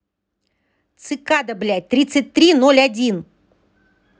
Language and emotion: Russian, angry